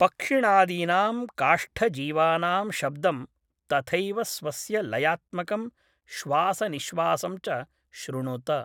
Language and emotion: Sanskrit, neutral